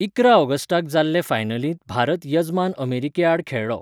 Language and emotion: Goan Konkani, neutral